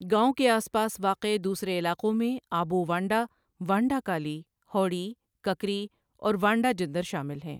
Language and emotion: Urdu, neutral